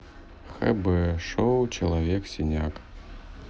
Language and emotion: Russian, neutral